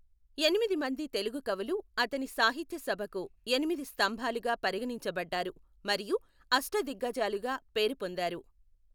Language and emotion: Telugu, neutral